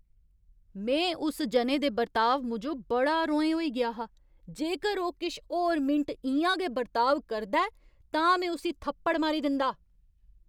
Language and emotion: Dogri, angry